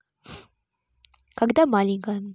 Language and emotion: Russian, neutral